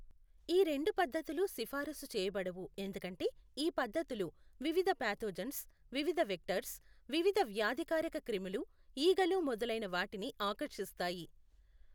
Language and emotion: Telugu, neutral